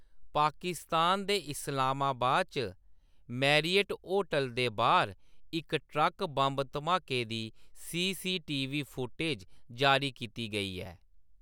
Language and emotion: Dogri, neutral